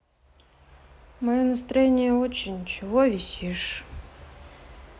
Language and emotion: Russian, sad